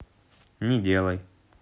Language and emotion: Russian, neutral